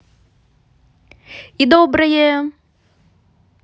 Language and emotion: Russian, positive